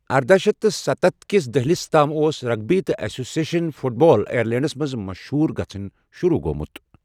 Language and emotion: Kashmiri, neutral